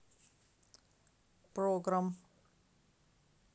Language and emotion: Russian, neutral